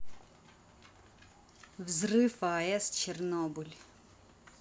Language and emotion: Russian, neutral